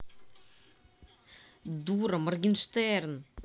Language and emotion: Russian, angry